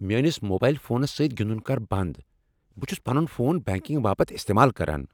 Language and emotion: Kashmiri, angry